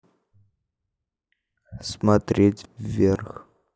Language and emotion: Russian, neutral